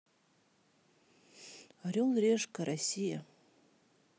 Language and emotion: Russian, neutral